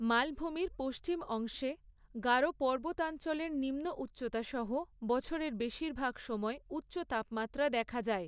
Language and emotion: Bengali, neutral